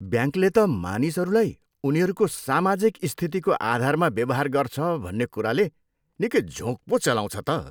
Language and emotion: Nepali, disgusted